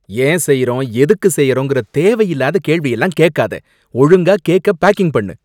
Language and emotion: Tamil, angry